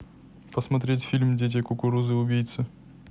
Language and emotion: Russian, neutral